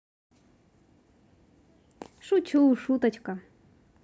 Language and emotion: Russian, positive